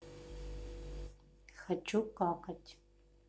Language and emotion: Russian, neutral